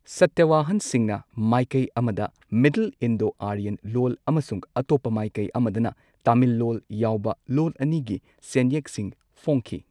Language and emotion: Manipuri, neutral